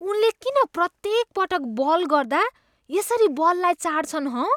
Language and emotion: Nepali, disgusted